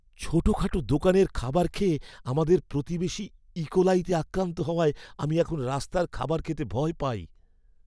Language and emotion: Bengali, fearful